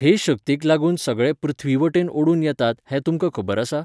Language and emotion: Goan Konkani, neutral